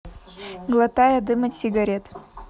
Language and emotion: Russian, neutral